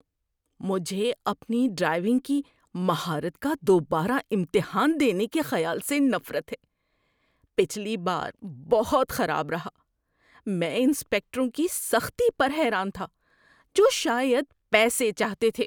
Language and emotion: Urdu, disgusted